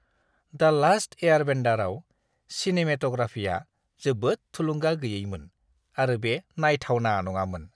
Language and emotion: Bodo, disgusted